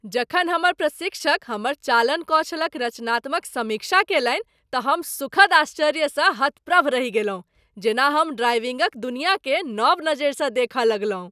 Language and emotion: Maithili, surprised